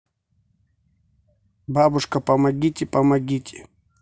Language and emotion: Russian, neutral